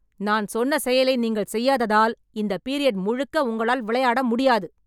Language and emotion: Tamil, angry